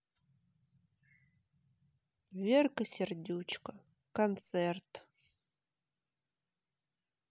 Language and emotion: Russian, sad